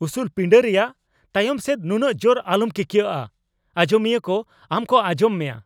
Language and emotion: Santali, angry